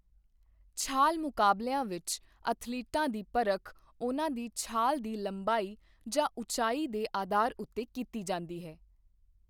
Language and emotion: Punjabi, neutral